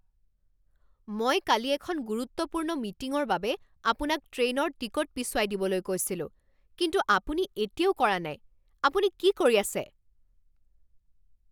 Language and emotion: Assamese, angry